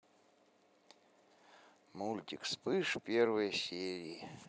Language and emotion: Russian, sad